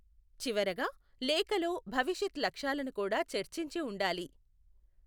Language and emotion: Telugu, neutral